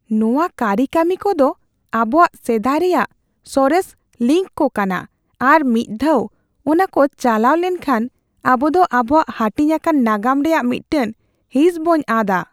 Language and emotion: Santali, fearful